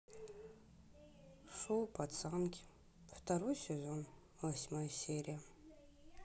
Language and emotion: Russian, sad